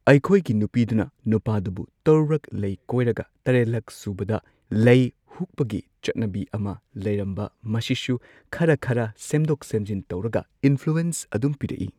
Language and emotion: Manipuri, neutral